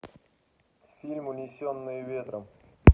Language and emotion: Russian, neutral